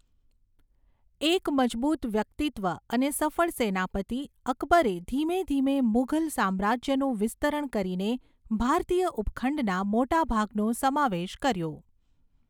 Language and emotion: Gujarati, neutral